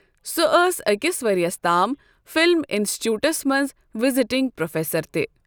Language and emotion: Kashmiri, neutral